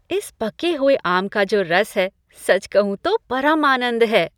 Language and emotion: Hindi, happy